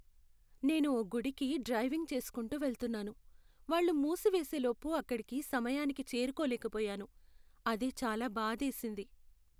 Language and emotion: Telugu, sad